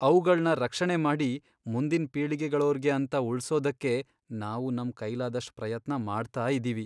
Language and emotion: Kannada, sad